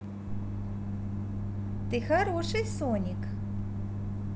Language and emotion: Russian, positive